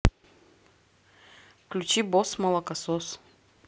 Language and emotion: Russian, neutral